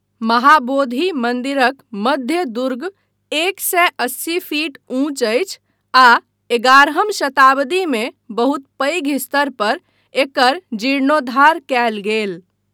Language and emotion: Maithili, neutral